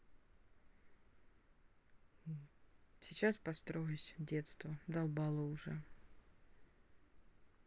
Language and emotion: Russian, neutral